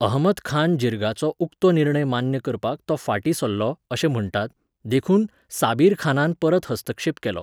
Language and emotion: Goan Konkani, neutral